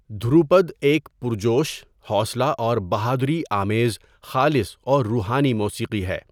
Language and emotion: Urdu, neutral